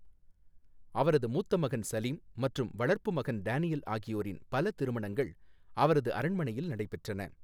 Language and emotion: Tamil, neutral